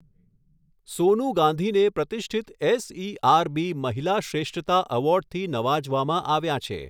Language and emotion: Gujarati, neutral